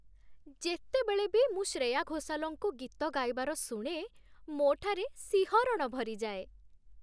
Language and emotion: Odia, happy